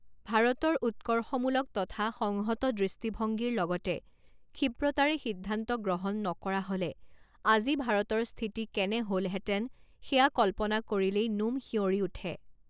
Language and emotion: Assamese, neutral